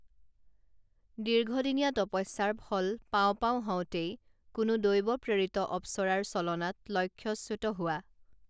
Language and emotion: Assamese, neutral